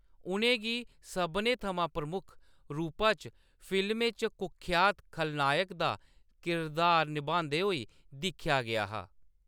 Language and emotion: Dogri, neutral